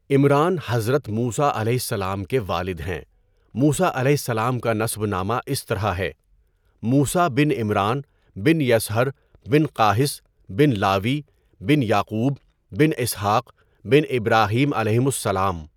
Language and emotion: Urdu, neutral